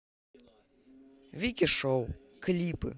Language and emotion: Russian, neutral